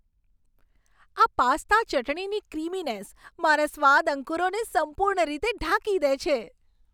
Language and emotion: Gujarati, happy